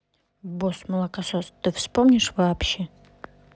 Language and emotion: Russian, neutral